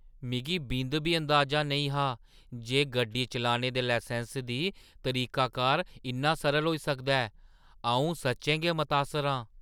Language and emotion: Dogri, surprised